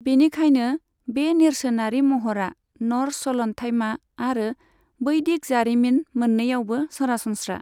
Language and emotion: Bodo, neutral